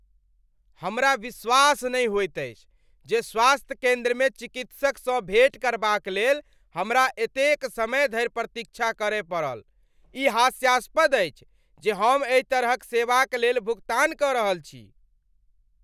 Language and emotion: Maithili, angry